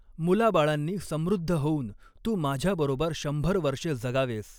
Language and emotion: Marathi, neutral